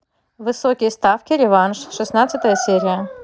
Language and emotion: Russian, neutral